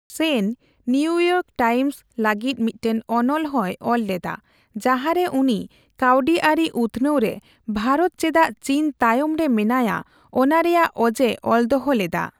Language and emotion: Santali, neutral